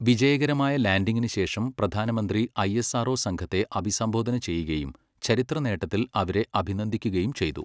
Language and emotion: Malayalam, neutral